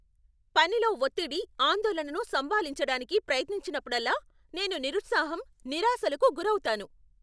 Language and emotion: Telugu, angry